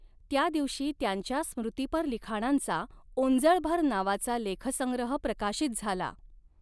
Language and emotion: Marathi, neutral